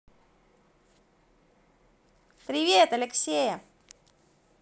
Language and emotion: Russian, positive